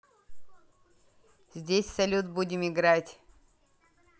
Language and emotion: Russian, neutral